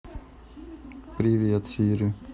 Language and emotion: Russian, neutral